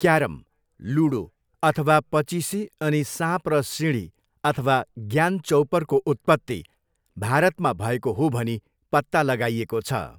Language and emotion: Nepali, neutral